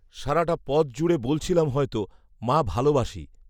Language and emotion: Bengali, neutral